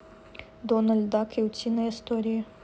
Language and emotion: Russian, neutral